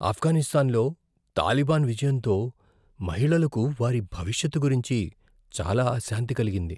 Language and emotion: Telugu, fearful